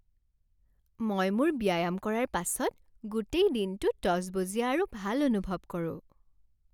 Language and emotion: Assamese, happy